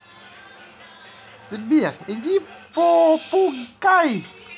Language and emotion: Russian, positive